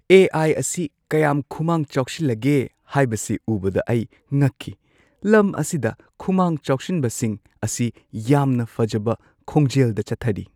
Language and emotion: Manipuri, surprised